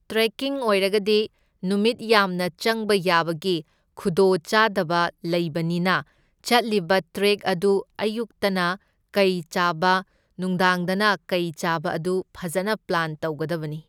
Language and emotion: Manipuri, neutral